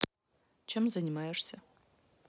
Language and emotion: Russian, neutral